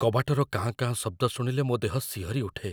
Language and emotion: Odia, fearful